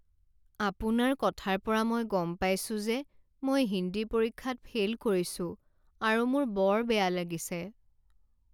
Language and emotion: Assamese, sad